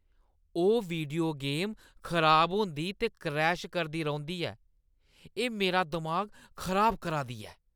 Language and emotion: Dogri, angry